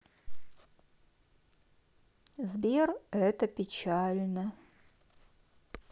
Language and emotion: Russian, sad